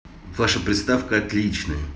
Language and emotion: Russian, positive